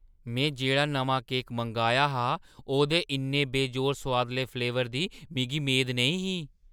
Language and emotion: Dogri, surprised